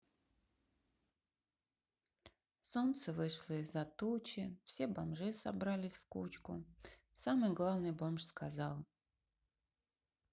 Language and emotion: Russian, sad